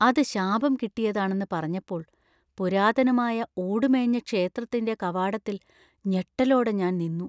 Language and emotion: Malayalam, fearful